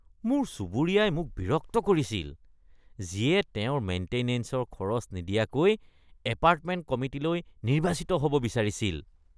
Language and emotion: Assamese, disgusted